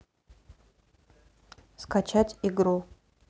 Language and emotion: Russian, neutral